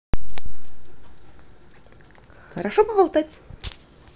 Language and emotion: Russian, positive